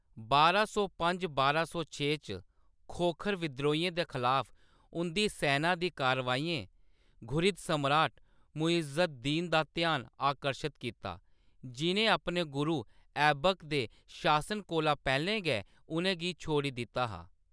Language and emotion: Dogri, neutral